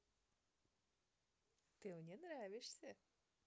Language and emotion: Russian, positive